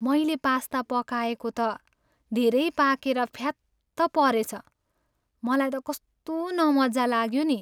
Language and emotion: Nepali, sad